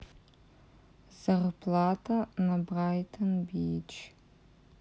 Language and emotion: Russian, neutral